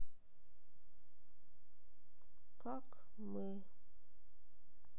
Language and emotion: Russian, sad